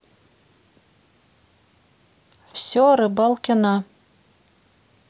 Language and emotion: Russian, neutral